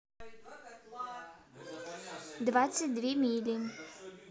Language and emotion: Russian, neutral